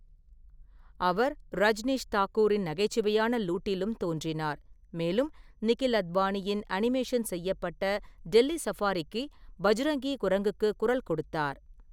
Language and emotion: Tamil, neutral